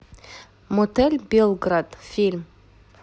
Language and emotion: Russian, neutral